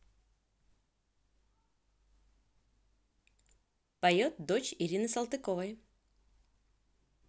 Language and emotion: Russian, neutral